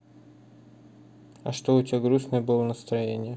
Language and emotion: Russian, neutral